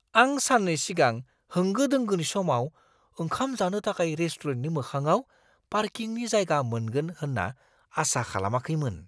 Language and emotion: Bodo, surprised